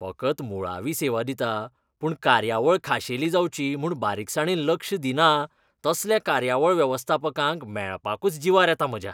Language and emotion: Goan Konkani, disgusted